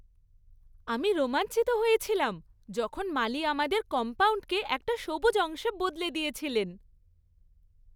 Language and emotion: Bengali, happy